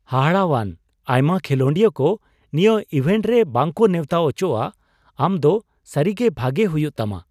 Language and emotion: Santali, surprised